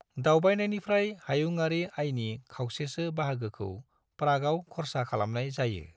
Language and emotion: Bodo, neutral